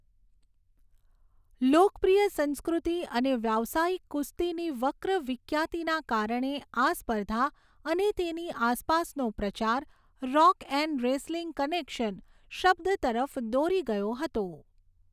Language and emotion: Gujarati, neutral